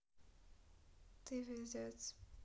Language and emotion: Russian, sad